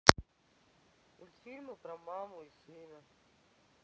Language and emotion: Russian, sad